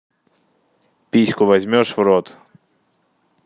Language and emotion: Russian, neutral